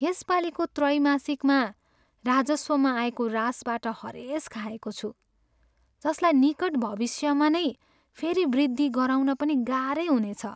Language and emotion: Nepali, sad